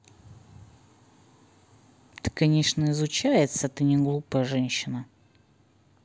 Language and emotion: Russian, neutral